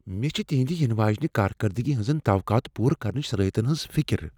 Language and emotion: Kashmiri, fearful